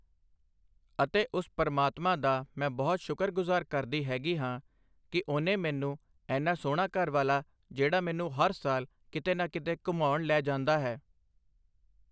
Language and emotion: Punjabi, neutral